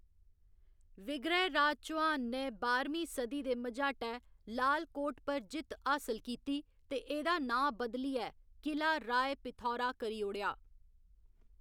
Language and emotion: Dogri, neutral